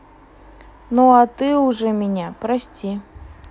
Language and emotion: Russian, neutral